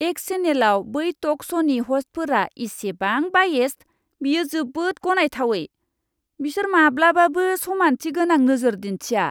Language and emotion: Bodo, disgusted